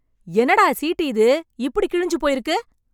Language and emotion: Tamil, angry